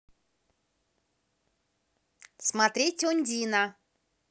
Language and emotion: Russian, positive